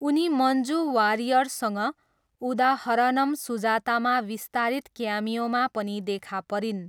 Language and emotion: Nepali, neutral